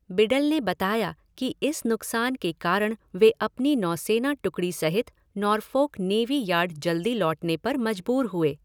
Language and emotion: Hindi, neutral